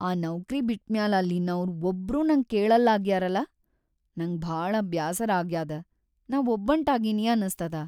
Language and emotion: Kannada, sad